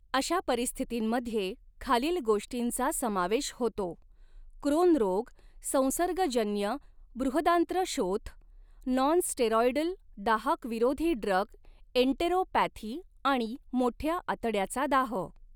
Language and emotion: Marathi, neutral